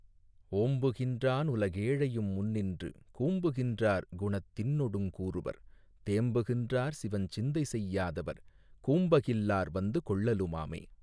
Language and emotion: Tamil, neutral